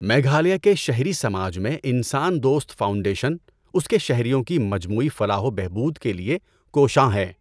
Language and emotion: Urdu, neutral